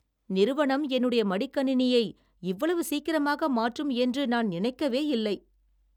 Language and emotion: Tamil, surprised